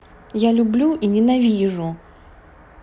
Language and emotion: Russian, neutral